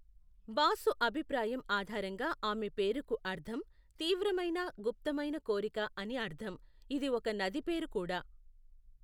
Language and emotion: Telugu, neutral